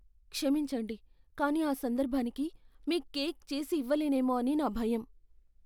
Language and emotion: Telugu, fearful